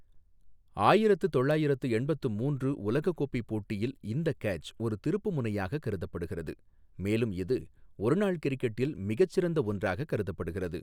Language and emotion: Tamil, neutral